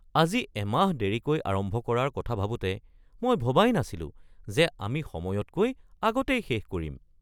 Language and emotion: Assamese, surprised